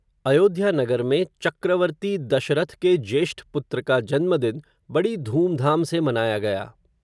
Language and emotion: Hindi, neutral